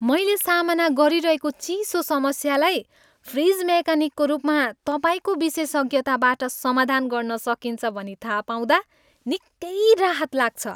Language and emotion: Nepali, happy